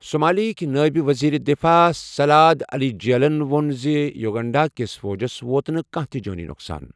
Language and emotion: Kashmiri, neutral